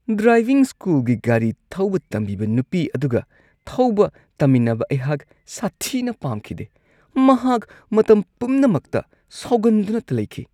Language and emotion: Manipuri, disgusted